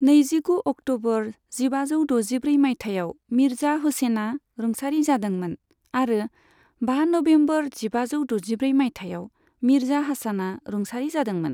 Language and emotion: Bodo, neutral